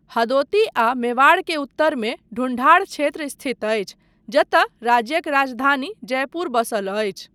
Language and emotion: Maithili, neutral